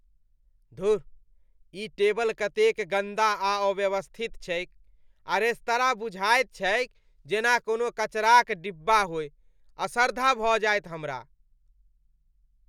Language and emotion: Maithili, disgusted